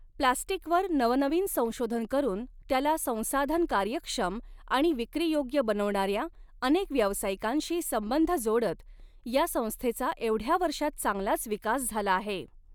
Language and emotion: Marathi, neutral